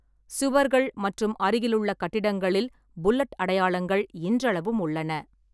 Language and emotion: Tamil, neutral